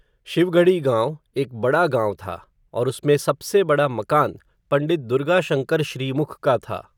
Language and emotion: Hindi, neutral